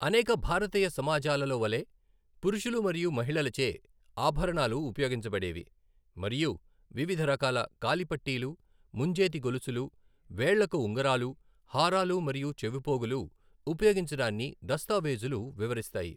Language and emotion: Telugu, neutral